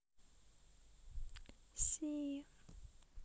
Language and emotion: Russian, neutral